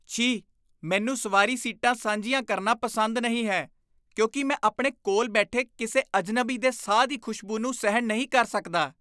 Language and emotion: Punjabi, disgusted